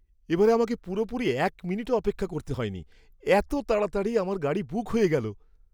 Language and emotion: Bengali, surprised